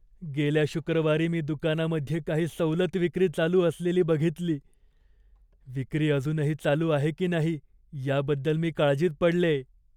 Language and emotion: Marathi, fearful